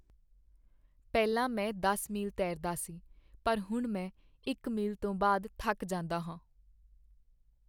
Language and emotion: Punjabi, sad